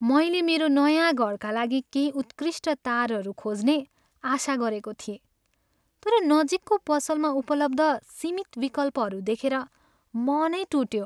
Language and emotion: Nepali, sad